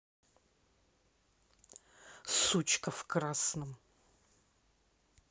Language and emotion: Russian, angry